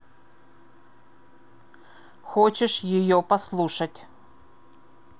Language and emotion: Russian, angry